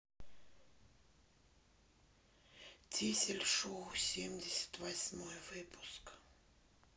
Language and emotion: Russian, neutral